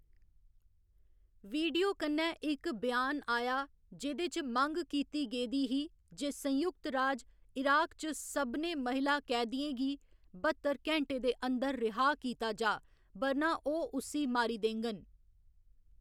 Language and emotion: Dogri, neutral